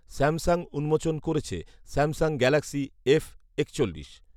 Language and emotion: Bengali, neutral